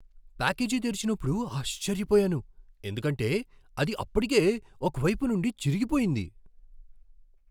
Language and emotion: Telugu, surprised